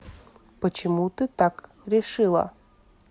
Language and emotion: Russian, neutral